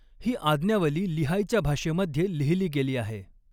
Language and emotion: Marathi, neutral